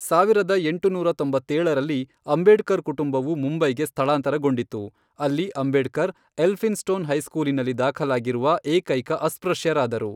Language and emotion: Kannada, neutral